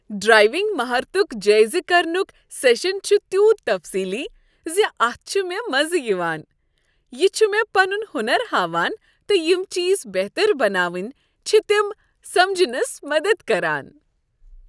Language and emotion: Kashmiri, happy